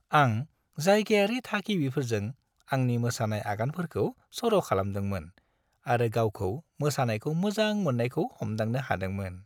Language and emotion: Bodo, happy